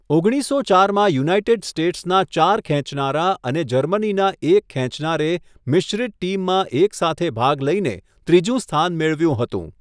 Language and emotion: Gujarati, neutral